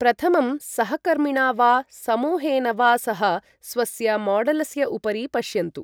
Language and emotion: Sanskrit, neutral